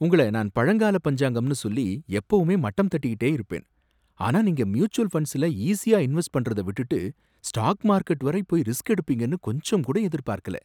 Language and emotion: Tamil, surprised